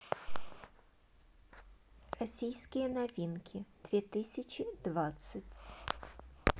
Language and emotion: Russian, neutral